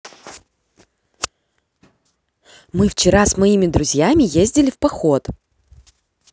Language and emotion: Russian, positive